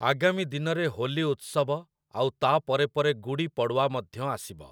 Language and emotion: Odia, neutral